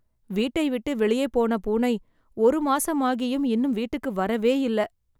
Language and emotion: Tamil, sad